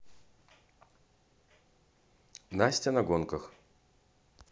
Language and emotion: Russian, neutral